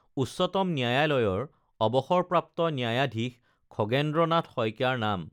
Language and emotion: Assamese, neutral